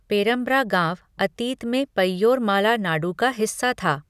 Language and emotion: Hindi, neutral